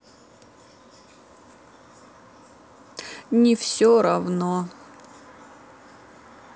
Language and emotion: Russian, sad